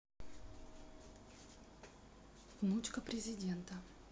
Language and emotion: Russian, neutral